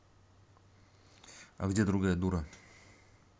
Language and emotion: Russian, neutral